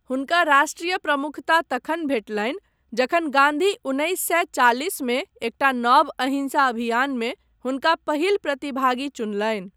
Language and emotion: Maithili, neutral